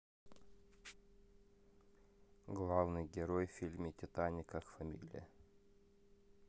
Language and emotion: Russian, neutral